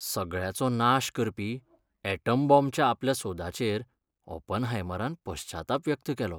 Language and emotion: Goan Konkani, sad